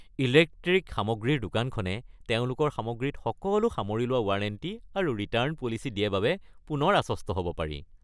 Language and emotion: Assamese, happy